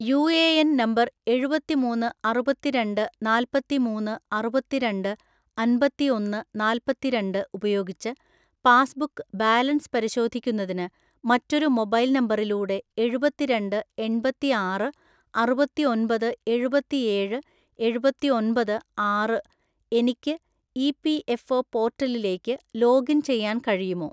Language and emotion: Malayalam, neutral